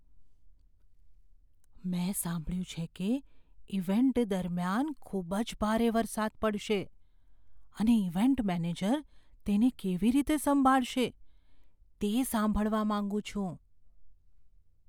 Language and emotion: Gujarati, fearful